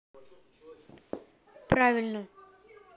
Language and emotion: Russian, neutral